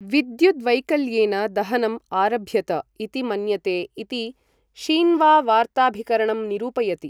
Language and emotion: Sanskrit, neutral